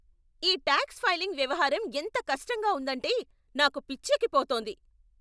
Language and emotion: Telugu, angry